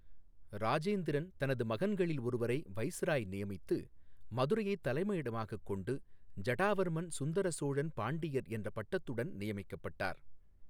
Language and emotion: Tamil, neutral